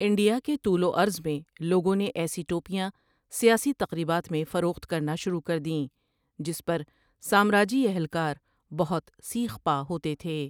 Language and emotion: Urdu, neutral